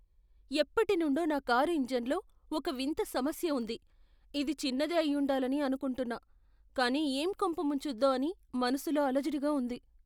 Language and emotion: Telugu, fearful